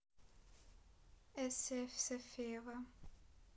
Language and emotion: Russian, neutral